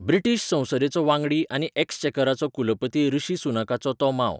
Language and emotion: Goan Konkani, neutral